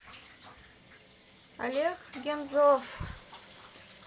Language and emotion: Russian, neutral